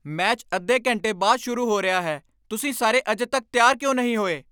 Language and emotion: Punjabi, angry